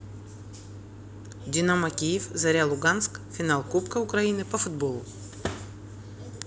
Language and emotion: Russian, neutral